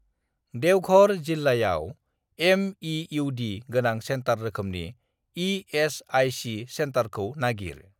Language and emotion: Bodo, neutral